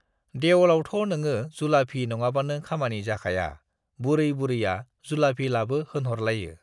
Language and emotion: Bodo, neutral